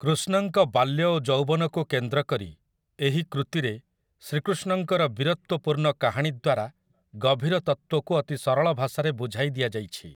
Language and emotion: Odia, neutral